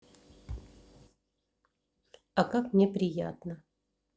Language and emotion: Russian, neutral